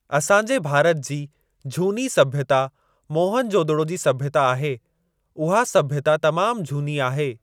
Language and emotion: Sindhi, neutral